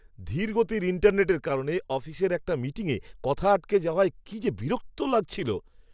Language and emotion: Bengali, angry